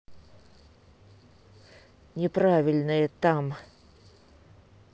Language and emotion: Russian, angry